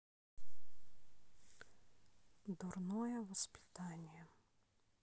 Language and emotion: Russian, sad